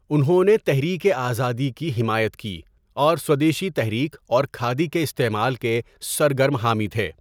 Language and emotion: Urdu, neutral